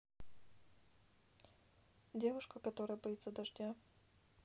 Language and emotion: Russian, neutral